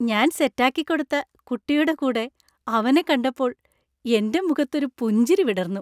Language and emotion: Malayalam, happy